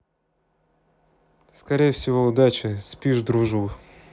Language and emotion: Russian, neutral